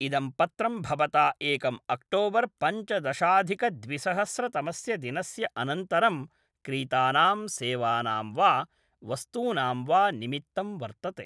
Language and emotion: Sanskrit, neutral